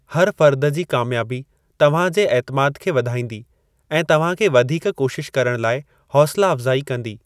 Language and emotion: Sindhi, neutral